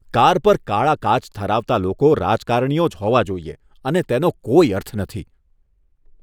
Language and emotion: Gujarati, disgusted